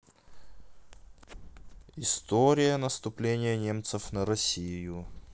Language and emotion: Russian, neutral